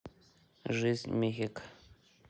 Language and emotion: Russian, neutral